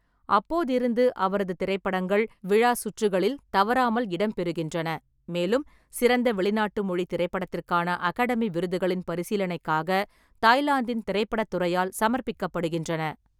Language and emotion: Tamil, neutral